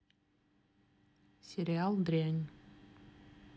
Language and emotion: Russian, neutral